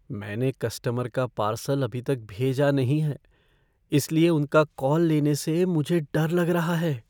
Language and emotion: Hindi, fearful